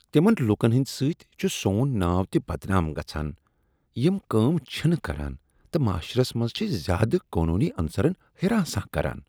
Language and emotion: Kashmiri, disgusted